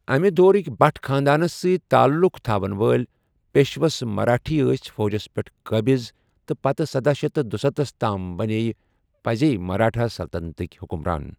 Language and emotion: Kashmiri, neutral